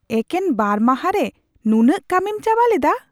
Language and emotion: Santali, surprised